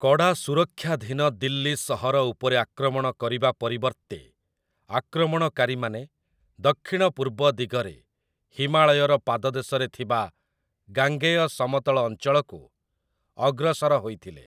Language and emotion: Odia, neutral